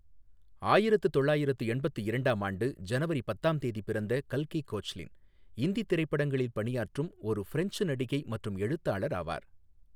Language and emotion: Tamil, neutral